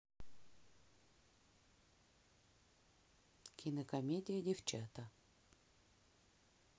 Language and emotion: Russian, neutral